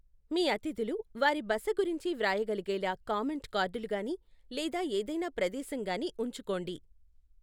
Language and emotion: Telugu, neutral